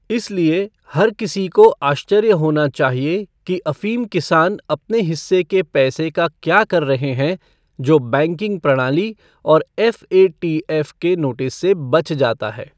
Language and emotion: Hindi, neutral